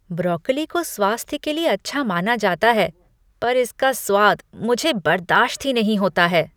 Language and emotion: Hindi, disgusted